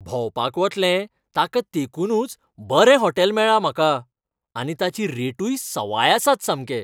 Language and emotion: Goan Konkani, happy